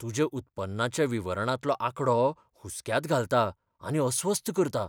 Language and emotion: Goan Konkani, fearful